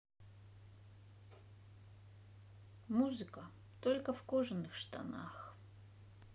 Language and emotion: Russian, sad